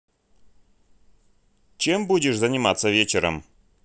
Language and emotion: Russian, neutral